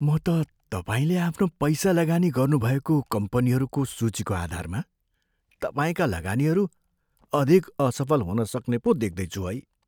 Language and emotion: Nepali, fearful